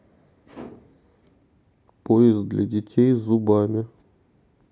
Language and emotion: Russian, neutral